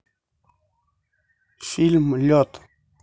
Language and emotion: Russian, neutral